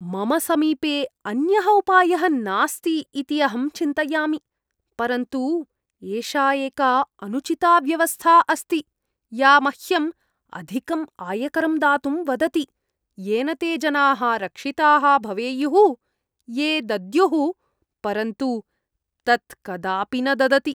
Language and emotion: Sanskrit, disgusted